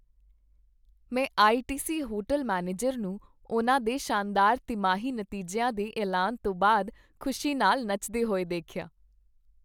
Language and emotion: Punjabi, happy